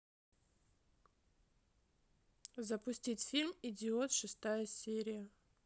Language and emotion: Russian, neutral